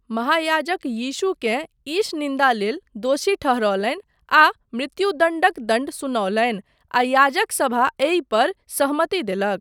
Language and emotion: Maithili, neutral